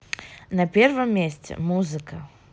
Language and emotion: Russian, neutral